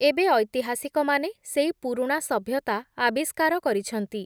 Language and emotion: Odia, neutral